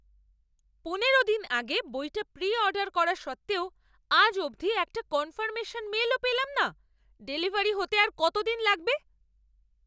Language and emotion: Bengali, angry